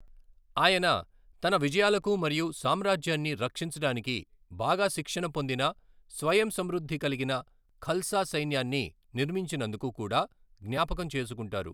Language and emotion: Telugu, neutral